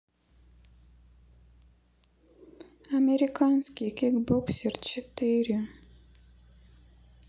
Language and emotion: Russian, sad